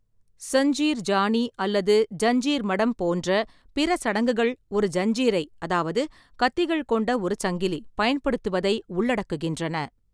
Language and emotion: Tamil, neutral